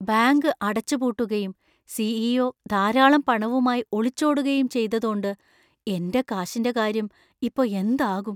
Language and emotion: Malayalam, fearful